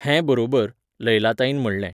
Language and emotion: Goan Konkani, neutral